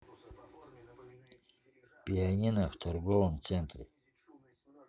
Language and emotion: Russian, neutral